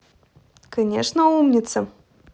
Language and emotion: Russian, positive